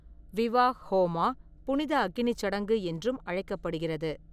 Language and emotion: Tamil, neutral